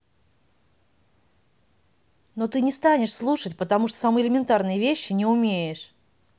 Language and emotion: Russian, angry